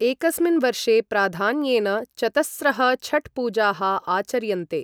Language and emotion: Sanskrit, neutral